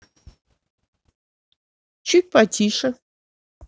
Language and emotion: Russian, neutral